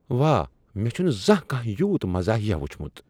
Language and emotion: Kashmiri, surprised